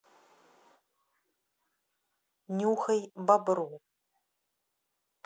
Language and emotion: Russian, neutral